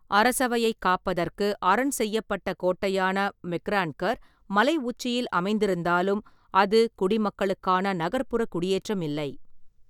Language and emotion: Tamil, neutral